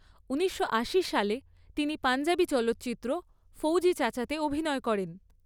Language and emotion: Bengali, neutral